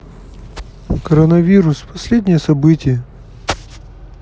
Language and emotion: Russian, sad